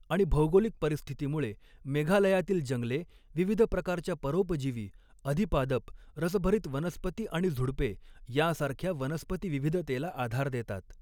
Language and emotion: Marathi, neutral